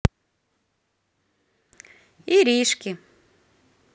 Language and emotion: Russian, positive